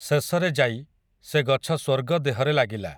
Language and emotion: Odia, neutral